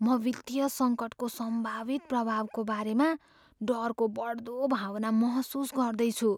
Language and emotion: Nepali, fearful